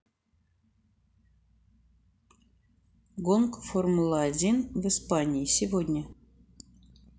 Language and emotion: Russian, neutral